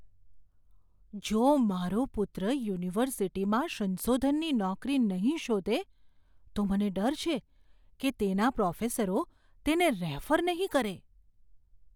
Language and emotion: Gujarati, fearful